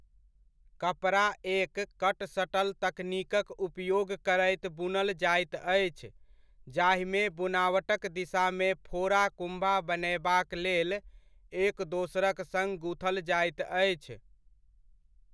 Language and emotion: Maithili, neutral